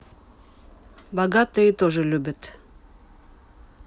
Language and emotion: Russian, neutral